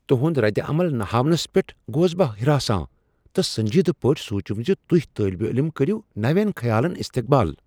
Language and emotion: Kashmiri, surprised